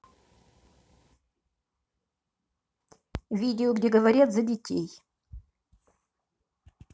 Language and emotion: Russian, neutral